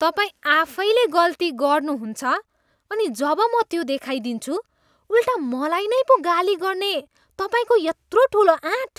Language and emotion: Nepali, disgusted